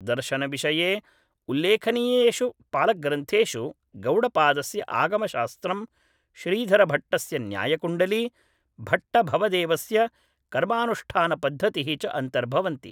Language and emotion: Sanskrit, neutral